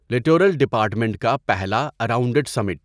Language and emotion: Urdu, neutral